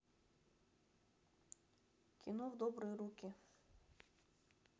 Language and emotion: Russian, neutral